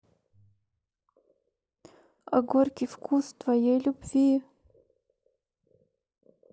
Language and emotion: Russian, sad